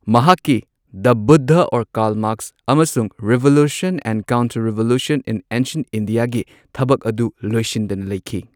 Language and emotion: Manipuri, neutral